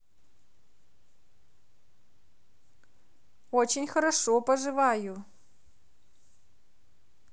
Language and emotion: Russian, positive